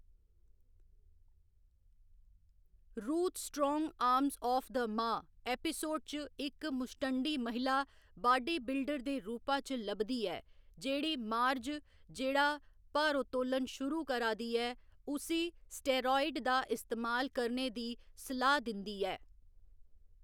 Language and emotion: Dogri, neutral